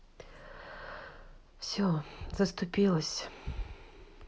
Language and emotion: Russian, sad